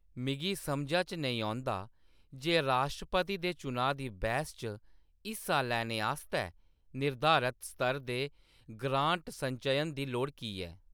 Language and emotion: Dogri, neutral